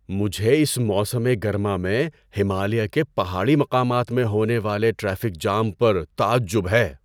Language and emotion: Urdu, surprised